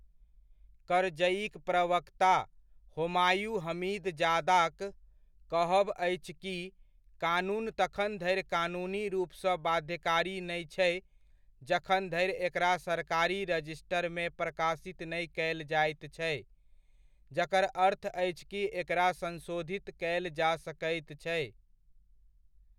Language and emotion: Maithili, neutral